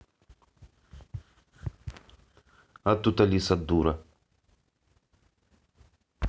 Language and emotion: Russian, angry